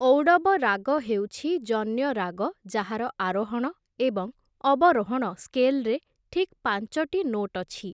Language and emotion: Odia, neutral